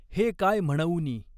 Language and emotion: Marathi, neutral